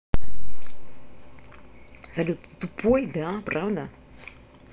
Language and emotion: Russian, angry